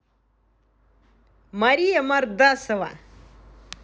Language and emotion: Russian, positive